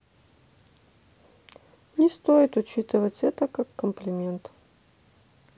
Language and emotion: Russian, sad